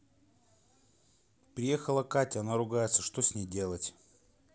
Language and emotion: Russian, neutral